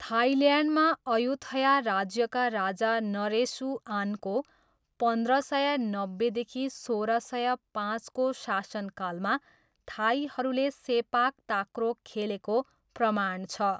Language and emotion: Nepali, neutral